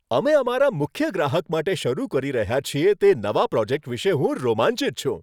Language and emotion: Gujarati, happy